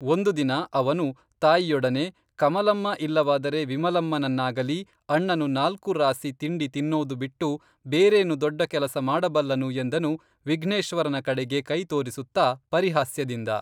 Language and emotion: Kannada, neutral